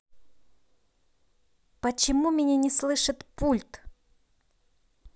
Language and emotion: Russian, neutral